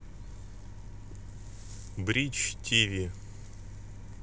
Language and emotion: Russian, neutral